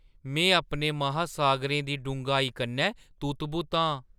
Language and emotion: Dogri, surprised